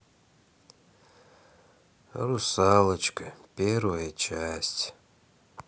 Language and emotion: Russian, sad